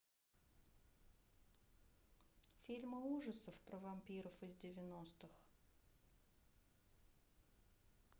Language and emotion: Russian, neutral